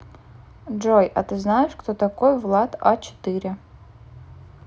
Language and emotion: Russian, neutral